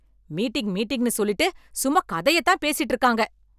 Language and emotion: Tamil, angry